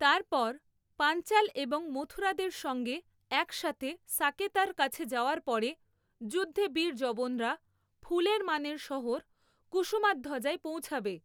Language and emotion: Bengali, neutral